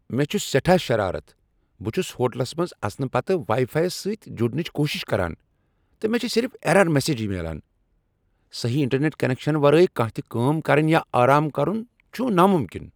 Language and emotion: Kashmiri, angry